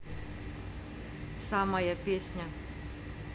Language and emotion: Russian, neutral